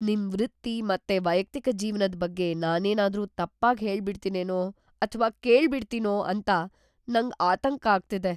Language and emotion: Kannada, fearful